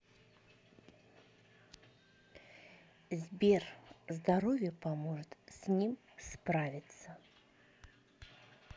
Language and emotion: Russian, neutral